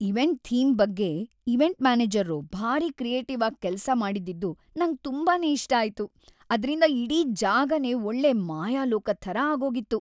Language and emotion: Kannada, happy